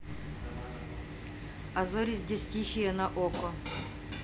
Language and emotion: Russian, neutral